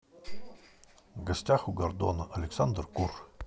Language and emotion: Russian, neutral